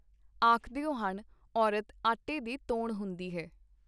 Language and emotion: Punjabi, neutral